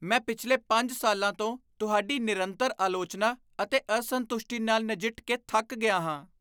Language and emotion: Punjabi, disgusted